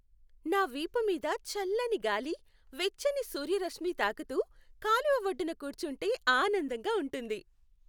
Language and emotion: Telugu, happy